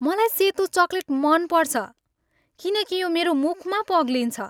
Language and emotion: Nepali, happy